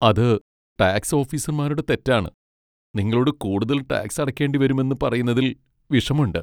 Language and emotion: Malayalam, sad